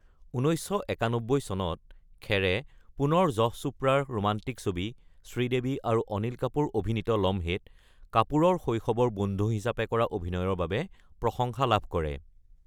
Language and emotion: Assamese, neutral